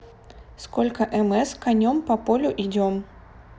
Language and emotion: Russian, neutral